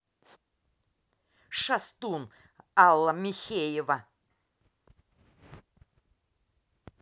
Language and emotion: Russian, angry